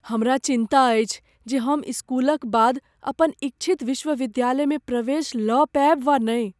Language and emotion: Maithili, fearful